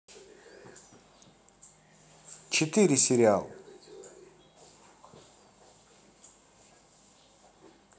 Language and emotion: Russian, positive